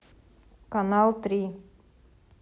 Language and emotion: Russian, neutral